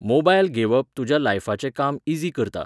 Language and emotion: Goan Konkani, neutral